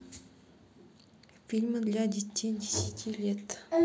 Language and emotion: Russian, neutral